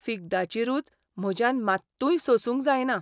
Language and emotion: Goan Konkani, disgusted